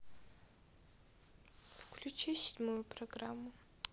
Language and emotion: Russian, sad